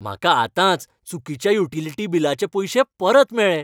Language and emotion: Goan Konkani, happy